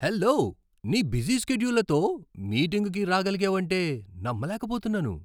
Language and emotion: Telugu, surprised